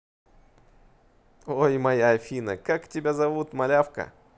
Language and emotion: Russian, positive